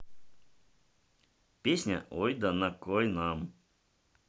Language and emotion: Russian, neutral